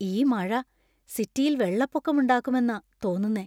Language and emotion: Malayalam, fearful